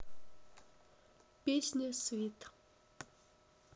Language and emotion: Russian, neutral